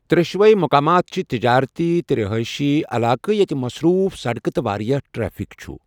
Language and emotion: Kashmiri, neutral